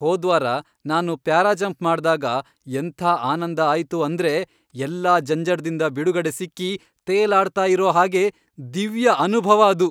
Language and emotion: Kannada, happy